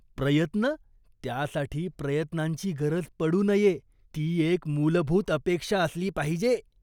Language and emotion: Marathi, disgusted